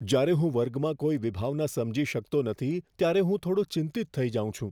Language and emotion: Gujarati, fearful